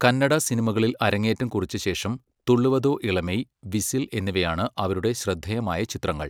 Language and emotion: Malayalam, neutral